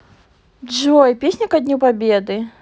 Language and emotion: Russian, neutral